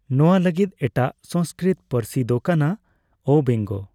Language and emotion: Santali, neutral